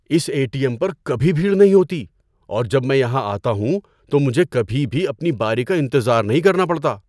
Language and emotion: Urdu, surprised